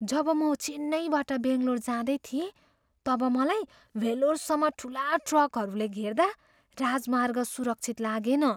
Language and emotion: Nepali, fearful